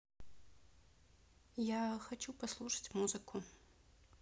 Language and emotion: Russian, neutral